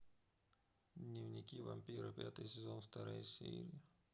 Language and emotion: Russian, sad